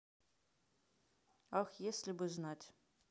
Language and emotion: Russian, neutral